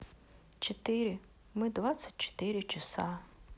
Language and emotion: Russian, neutral